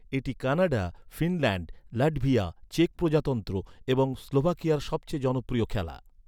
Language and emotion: Bengali, neutral